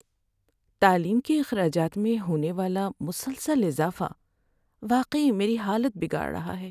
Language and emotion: Urdu, sad